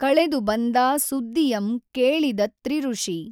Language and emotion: Kannada, neutral